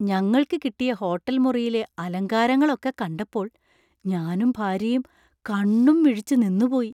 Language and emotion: Malayalam, surprised